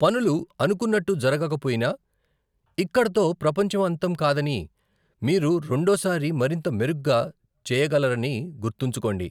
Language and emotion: Telugu, neutral